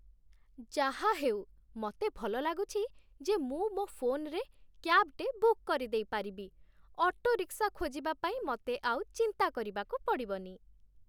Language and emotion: Odia, happy